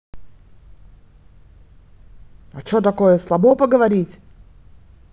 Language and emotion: Russian, angry